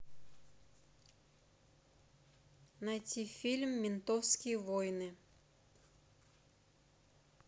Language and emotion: Russian, neutral